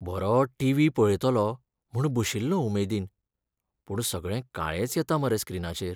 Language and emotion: Goan Konkani, sad